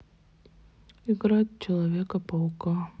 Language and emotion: Russian, sad